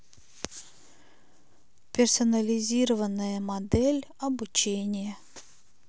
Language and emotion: Russian, neutral